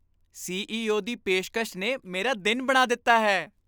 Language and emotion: Punjabi, happy